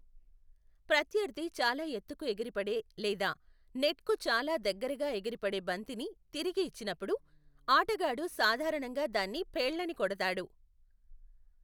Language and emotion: Telugu, neutral